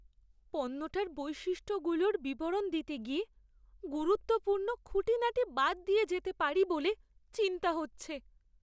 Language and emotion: Bengali, fearful